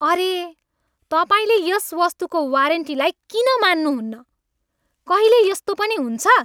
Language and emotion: Nepali, angry